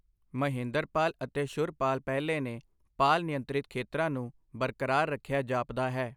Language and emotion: Punjabi, neutral